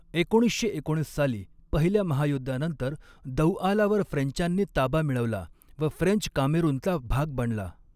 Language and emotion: Marathi, neutral